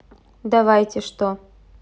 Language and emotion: Russian, neutral